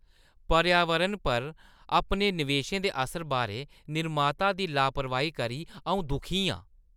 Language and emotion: Dogri, disgusted